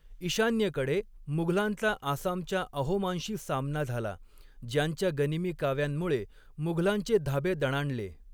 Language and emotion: Marathi, neutral